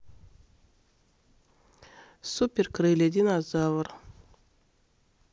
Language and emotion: Russian, neutral